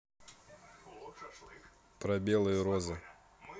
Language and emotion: Russian, neutral